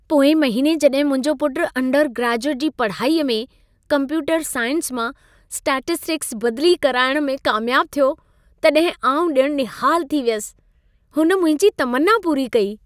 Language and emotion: Sindhi, happy